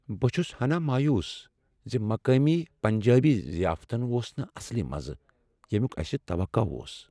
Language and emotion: Kashmiri, sad